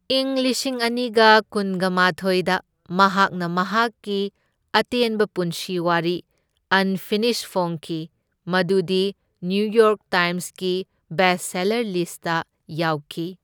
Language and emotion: Manipuri, neutral